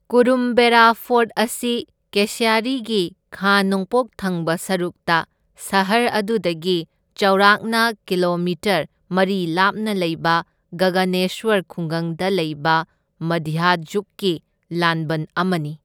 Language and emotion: Manipuri, neutral